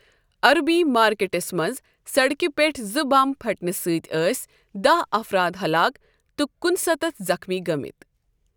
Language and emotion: Kashmiri, neutral